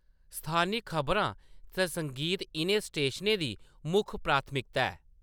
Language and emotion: Dogri, neutral